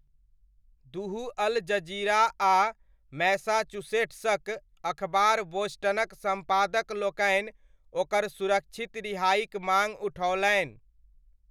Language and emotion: Maithili, neutral